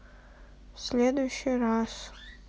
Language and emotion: Russian, sad